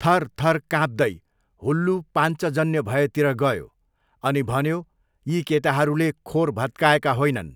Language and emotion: Nepali, neutral